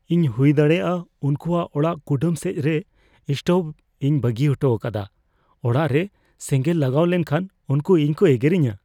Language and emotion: Santali, fearful